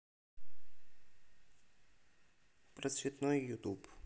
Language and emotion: Russian, neutral